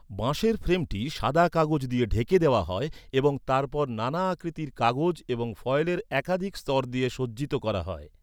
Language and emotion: Bengali, neutral